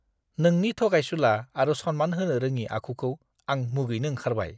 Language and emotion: Bodo, disgusted